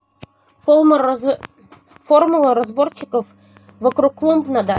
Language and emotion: Russian, neutral